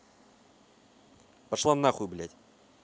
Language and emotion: Russian, angry